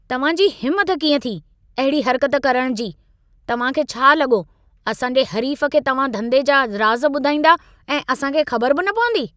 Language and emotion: Sindhi, angry